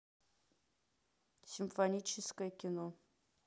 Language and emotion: Russian, neutral